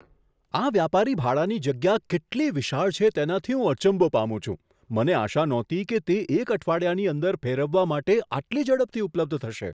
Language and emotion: Gujarati, surprised